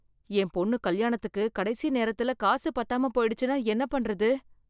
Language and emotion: Tamil, fearful